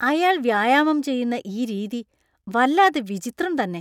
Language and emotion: Malayalam, disgusted